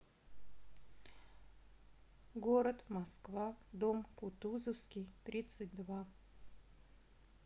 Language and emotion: Russian, neutral